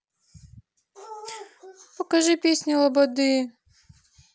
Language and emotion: Russian, sad